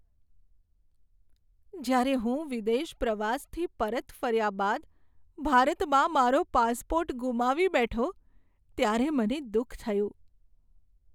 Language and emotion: Gujarati, sad